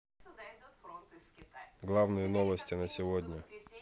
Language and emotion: Russian, neutral